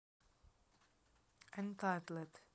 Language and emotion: Russian, neutral